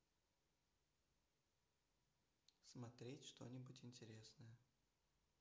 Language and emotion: Russian, neutral